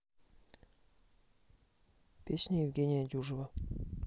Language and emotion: Russian, neutral